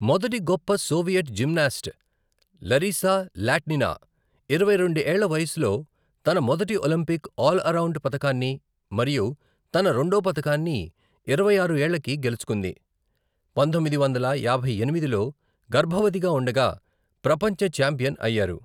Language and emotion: Telugu, neutral